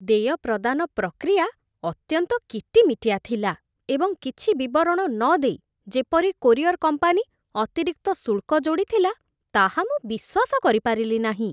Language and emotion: Odia, disgusted